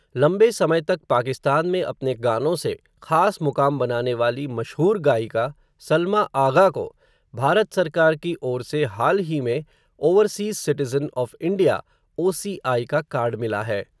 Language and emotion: Hindi, neutral